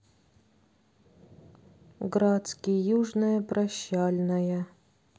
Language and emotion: Russian, sad